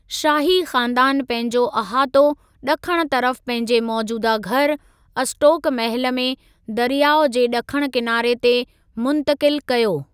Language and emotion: Sindhi, neutral